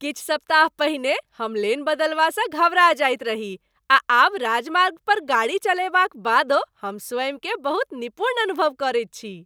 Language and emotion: Maithili, happy